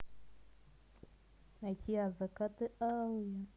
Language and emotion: Russian, positive